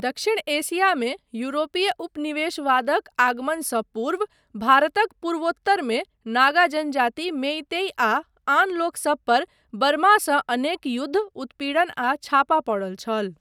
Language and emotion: Maithili, neutral